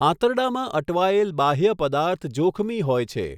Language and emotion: Gujarati, neutral